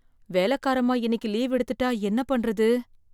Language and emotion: Tamil, fearful